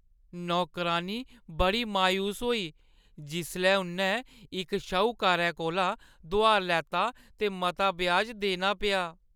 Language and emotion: Dogri, sad